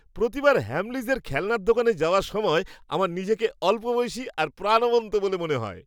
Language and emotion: Bengali, happy